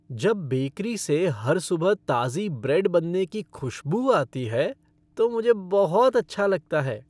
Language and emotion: Hindi, happy